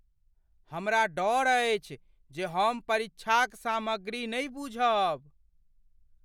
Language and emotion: Maithili, fearful